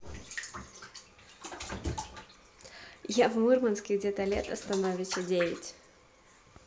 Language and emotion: Russian, positive